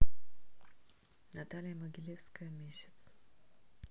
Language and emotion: Russian, neutral